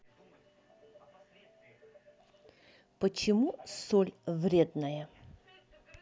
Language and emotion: Russian, neutral